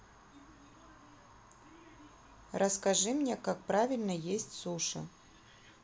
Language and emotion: Russian, neutral